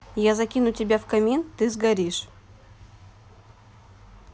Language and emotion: Russian, neutral